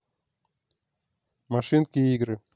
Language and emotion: Russian, neutral